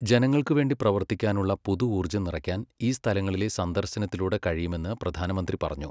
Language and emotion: Malayalam, neutral